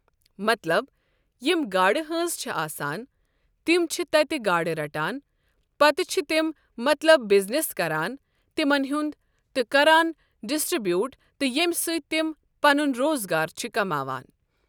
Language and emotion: Kashmiri, neutral